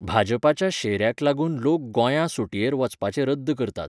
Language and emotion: Goan Konkani, neutral